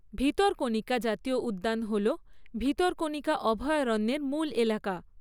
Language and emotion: Bengali, neutral